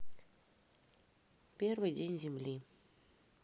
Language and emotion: Russian, neutral